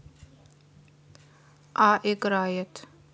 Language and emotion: Russian, neutral